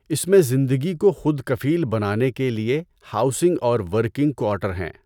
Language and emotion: Urdu, neutral